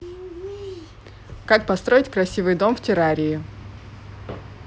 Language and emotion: Russian, neutral